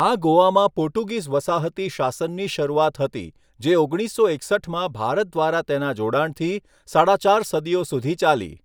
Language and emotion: Gujarati, neutral